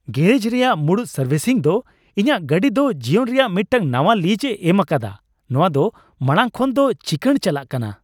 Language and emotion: Santali, happy